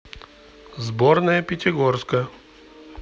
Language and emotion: Russian, neutral